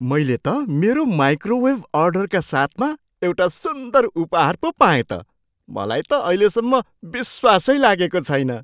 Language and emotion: Nepali, surprised